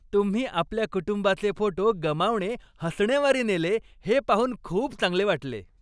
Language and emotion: Marathi, happy